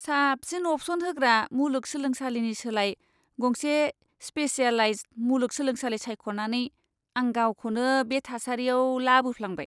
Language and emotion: Bodo, disgusted